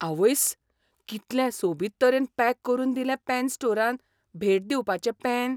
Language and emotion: Goan Konkani, surprised